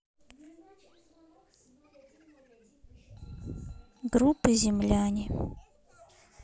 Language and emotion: Russian, neutral